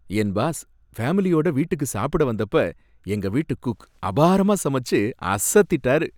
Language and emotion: Tamil, happy